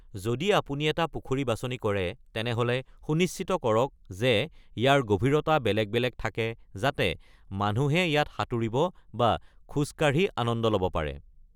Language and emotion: Assamese, neutral